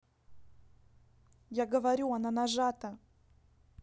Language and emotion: Russian, neutral